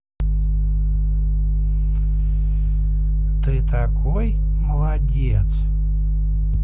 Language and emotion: Russian, positive